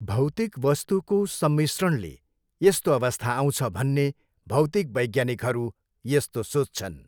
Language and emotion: Nepali, neutral